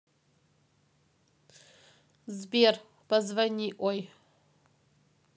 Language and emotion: Russian, neutral